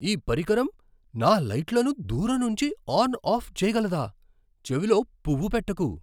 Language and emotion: Telugu, surprised